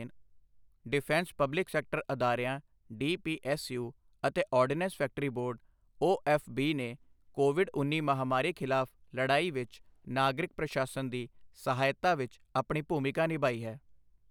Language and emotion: Punjabi, neutral